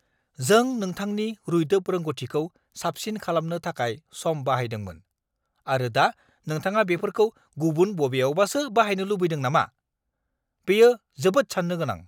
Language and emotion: Bodo, angry